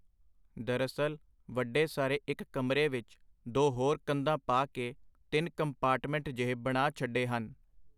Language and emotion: Punjabi, neutral